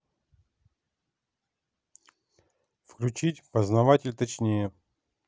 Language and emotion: Russian, neutral